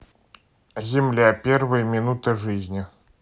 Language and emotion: Russian, neutral